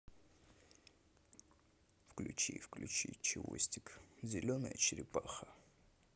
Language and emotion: Russian, sad